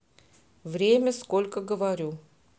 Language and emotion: Russian, neutral